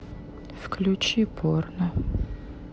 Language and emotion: Russian, sad